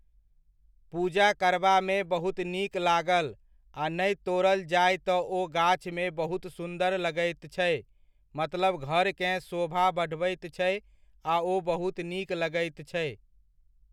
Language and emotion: Maithili, neutral